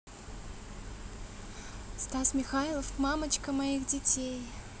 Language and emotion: Russian, positive